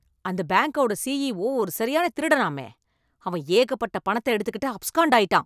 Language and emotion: Tamil, angry